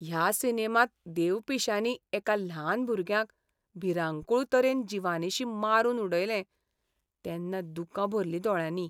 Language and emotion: Goan Konkani, sad